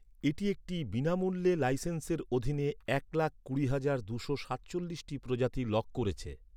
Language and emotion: Bengali, neutral